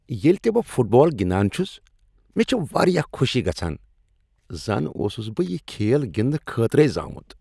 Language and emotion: Kashmiri, happy